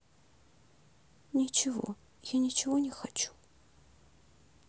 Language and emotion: Russian, sad